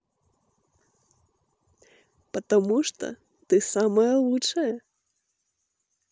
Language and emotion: Russian, positive